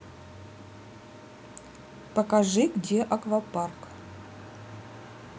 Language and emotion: Russian, neutral